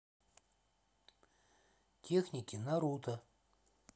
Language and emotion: Russian, neutral